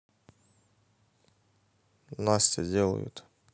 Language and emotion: Russian, neutral